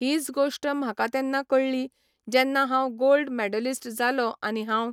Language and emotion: Goan Konkani, neutral